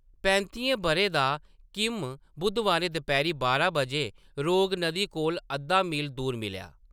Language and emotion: Dogri, neutral